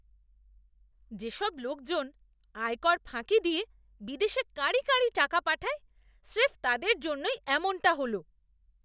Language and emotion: Bengali, disgusted